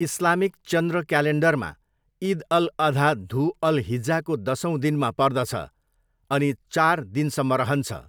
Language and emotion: Nepali, neutral